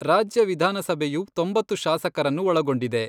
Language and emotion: Kannada, neutral